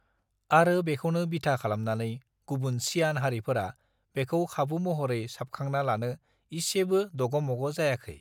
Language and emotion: Bodo, neutral